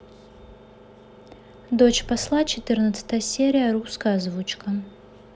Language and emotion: Russian, neutral